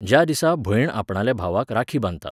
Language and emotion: Goan Konkani, neutral